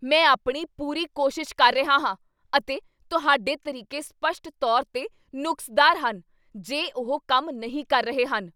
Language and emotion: Punjabi, angry